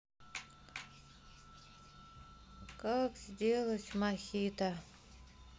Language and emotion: Russian, sad